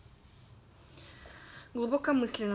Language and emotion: Russian, neutral